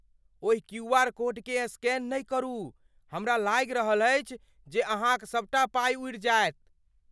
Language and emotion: Maithili, fearful